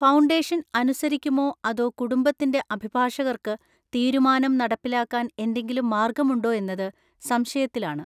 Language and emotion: Malayalam, neutral